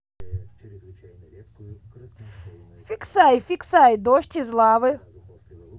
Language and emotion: Russian, positive